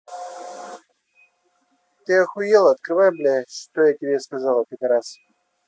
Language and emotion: Russian, angry